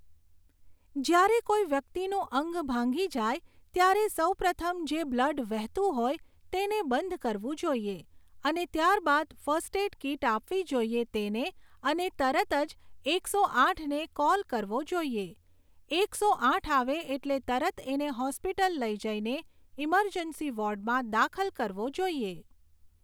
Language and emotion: Gujarati, neutral